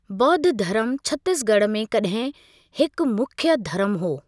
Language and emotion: Sindhi, neutral